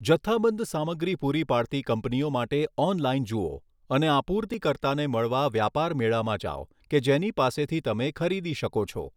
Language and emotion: Gujarati, neutral